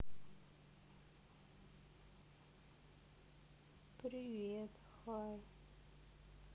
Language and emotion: Russian, sad